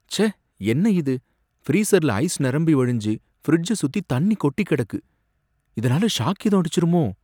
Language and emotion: Tamil, fearful